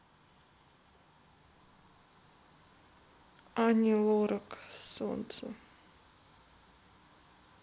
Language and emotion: Russian, sad